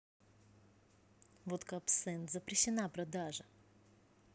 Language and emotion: Russian, neutral